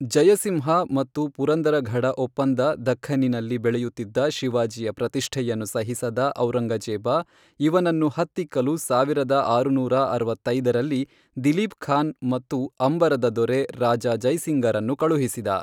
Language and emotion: Kannada, neutral